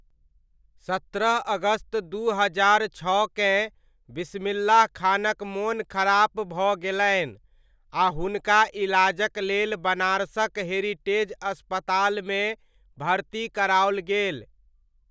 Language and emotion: Maithili, neutral